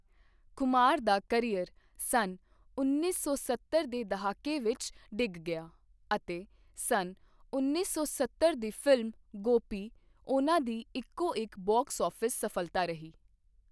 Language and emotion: Punjabi, neutral